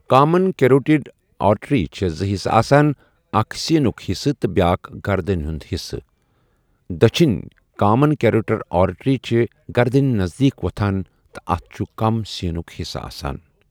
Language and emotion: Kashmiri, neutral